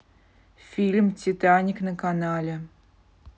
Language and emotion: Russian, neutral